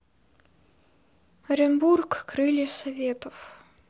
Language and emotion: Russian, sad